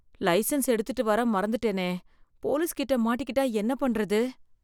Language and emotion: Tamil, fearful